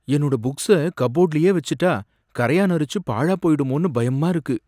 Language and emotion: Tamil, fearful